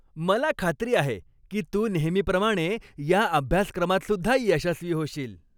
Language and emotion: Marathi, happy